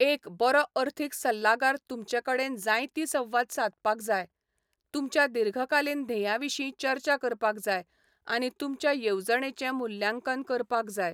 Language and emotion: Goan Konkani, neutral